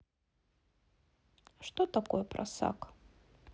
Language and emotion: Russian, neutral